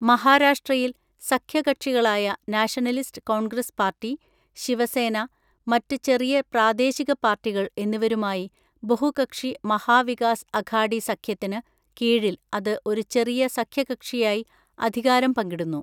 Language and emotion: Malayalam, neutral